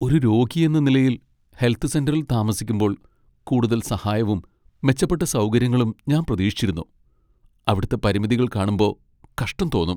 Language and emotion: Malayalam, sad